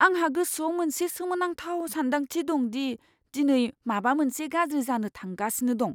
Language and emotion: Bodo, fearful